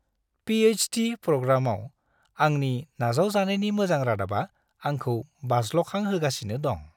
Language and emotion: Bodo, happy